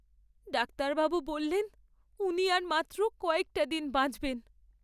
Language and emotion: Bengali, sad